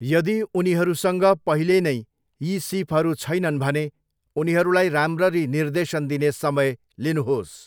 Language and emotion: Nepali, neutral